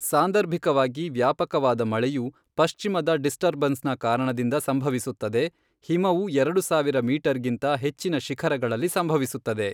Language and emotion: Kannada, neutral